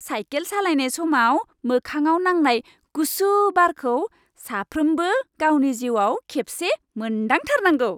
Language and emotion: Bodo, happy